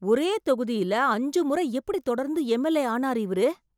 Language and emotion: Tamil, surprised